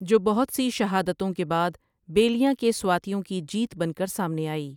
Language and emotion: Urdu, neutral